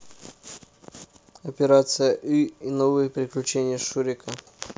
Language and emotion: Russian, neutral